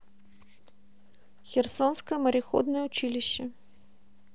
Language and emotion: Russian, neutral